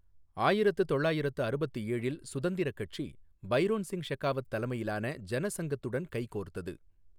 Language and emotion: Tamil, neutral